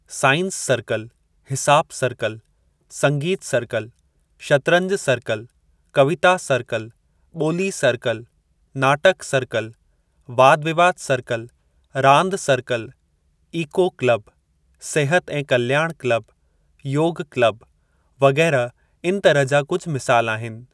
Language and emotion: Sindhi, neutral